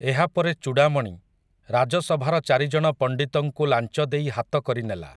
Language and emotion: Odia, neutral